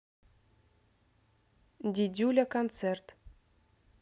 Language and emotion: Russian, neutral